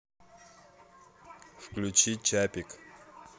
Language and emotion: Russian, neutral